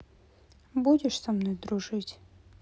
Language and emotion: Russian, sad